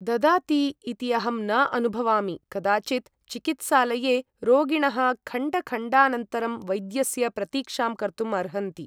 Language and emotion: Sanskrit, neutral